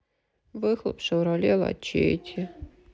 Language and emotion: Russian, sad